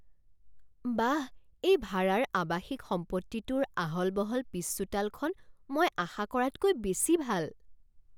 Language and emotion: Assamese, surprised